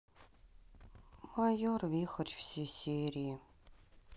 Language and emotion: Russian, sad